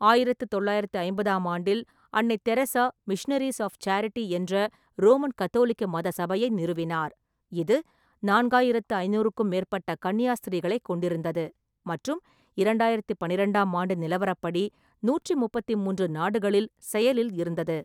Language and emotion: Tamil, neutral